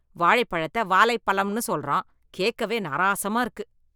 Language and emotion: Tamil, disgusted